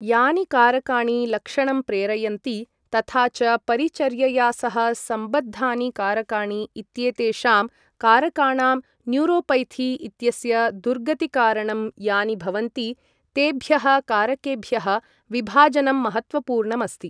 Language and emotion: Sanskrit, neutral